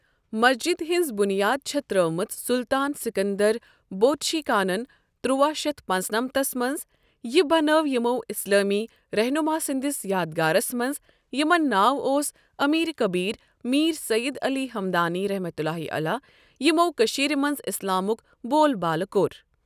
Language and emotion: Kashmiri, neutral